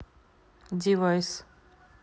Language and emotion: Russian, neutral